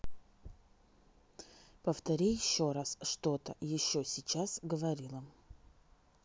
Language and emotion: Russian, neutral